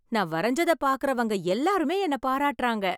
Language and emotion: Tamil, happy